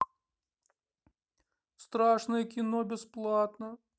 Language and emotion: Russian, sad